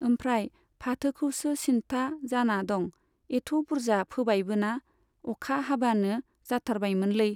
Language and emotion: Bodo, neutral